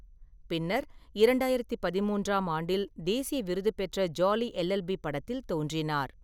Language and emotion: Tamil, neutral